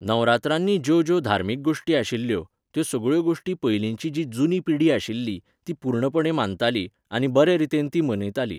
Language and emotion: Goan Konkani, neutral